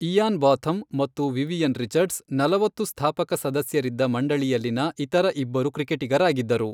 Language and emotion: Kannada, neutral